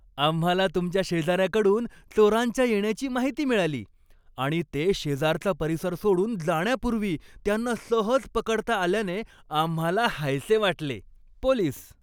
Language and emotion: Marathi, happy